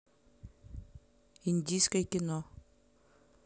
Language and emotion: Russian, neutral